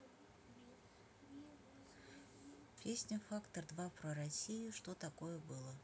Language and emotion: Russian, neutral